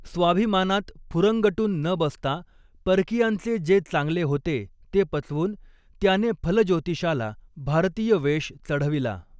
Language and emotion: Marathi, neutral